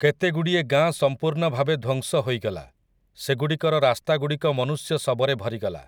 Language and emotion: Odia, neutral